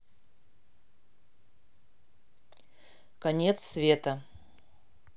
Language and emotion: Russian, neutral